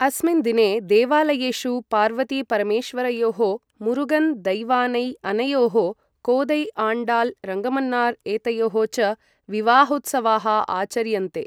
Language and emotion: Sanskrit, neutral